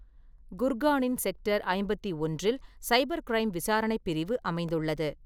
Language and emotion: Tamil, neutral